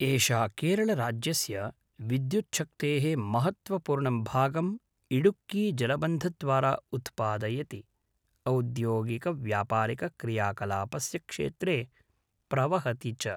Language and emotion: Sanskrit, neutral